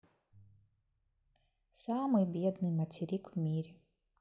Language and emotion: Russian, sad